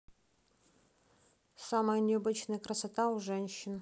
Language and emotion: Russian, neutral